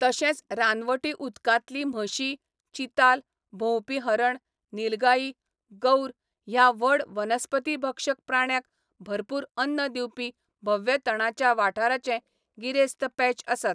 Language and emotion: Goan Konkani, neutral